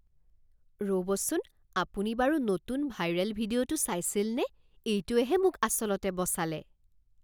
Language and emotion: Assamese, surprised